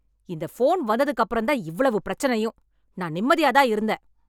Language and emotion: Tamil, angry